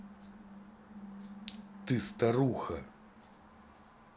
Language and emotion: Russian, angry